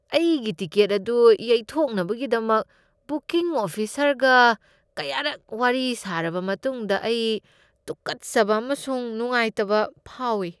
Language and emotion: Manipuri, disgusted